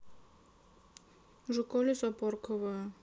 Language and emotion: Russian, neutral